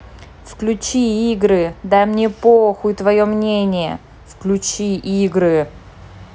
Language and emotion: Russian, angry